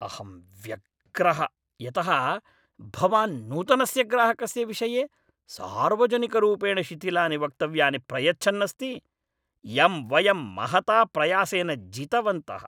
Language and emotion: Sanskrit, angry